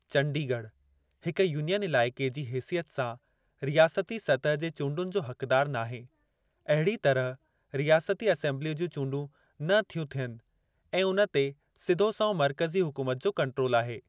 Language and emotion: Sindhi, neutral